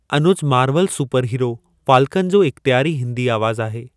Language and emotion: Sindhi, neutral